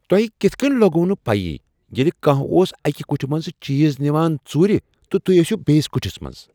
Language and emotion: Kashmiri, surprised